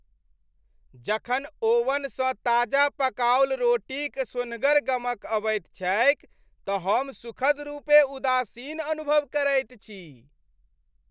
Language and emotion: Maithili, happy